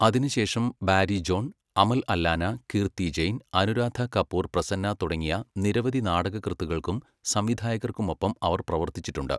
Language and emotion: Malayalam, neutral